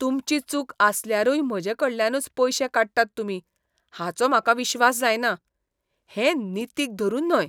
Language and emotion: Goan Konkani, disgusted